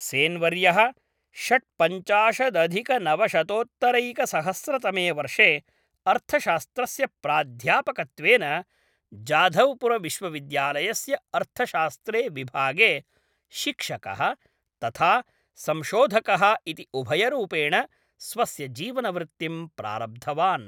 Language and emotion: Sanskrit, neutral